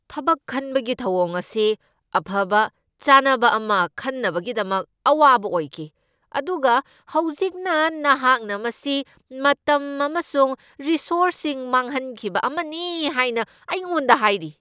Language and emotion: Manipuri, angry